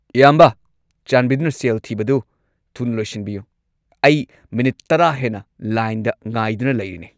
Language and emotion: Manipuri, angry